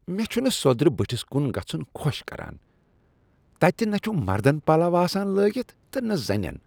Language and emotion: Kashmiri, disgusted